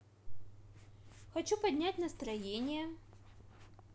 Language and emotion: Russian, positive